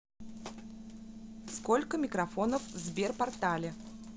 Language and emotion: Russian, neutral